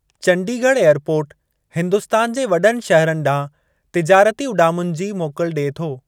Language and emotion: Sindhi, neutral